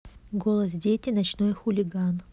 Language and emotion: Russian, neutral